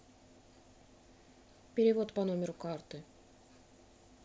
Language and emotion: Russian, neutral